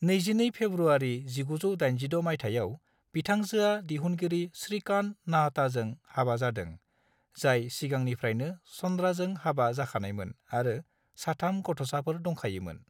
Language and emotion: Bodo, neutral